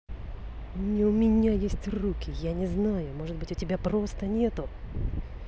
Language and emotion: Russian, angry